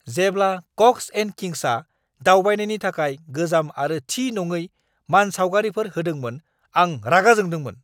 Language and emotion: Bodo, angry